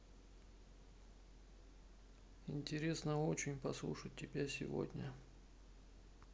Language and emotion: Russian, neutral